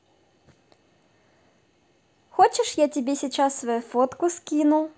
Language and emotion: Russian, positive